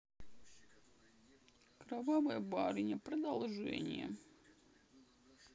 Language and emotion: Russian, sad